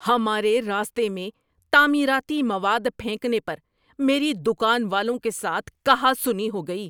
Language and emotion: Urdu, angry